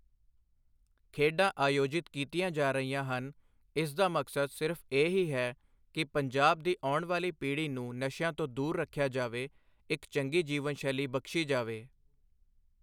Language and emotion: Punjabi, neutral